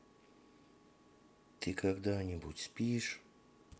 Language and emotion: Russian, neutral